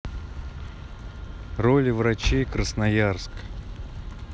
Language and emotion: Russian, neutral